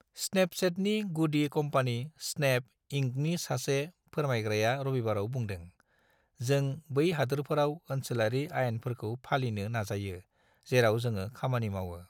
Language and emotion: Bodo, neutral